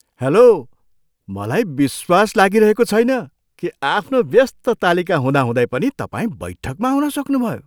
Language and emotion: Nepali, surprised